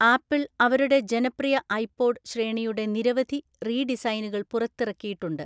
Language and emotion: Malayalam, neutral